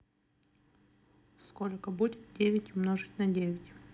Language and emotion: Russian, neutral